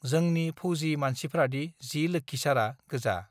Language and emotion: Bodo, neutral